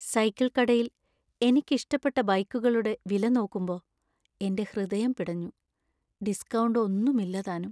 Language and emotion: Malayalam, sad